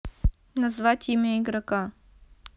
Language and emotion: Russian, neutral